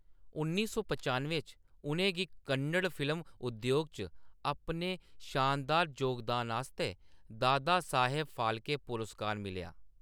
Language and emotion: Dogri, neutral